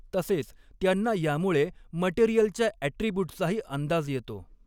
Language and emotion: Marathi, neutral